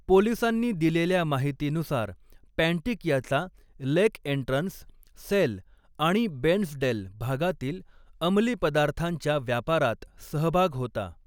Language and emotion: Marathi, neutral